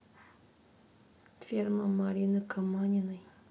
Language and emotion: Russian, sad